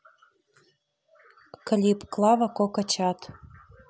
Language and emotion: Russian, neutral